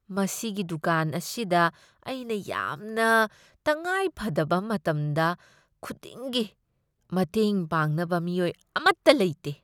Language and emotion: Manipuri, disgusted